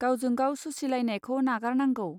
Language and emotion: Bodo, neutral